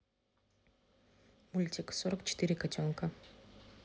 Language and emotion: Russian, neutral